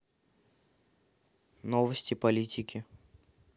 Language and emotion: Russian, neutral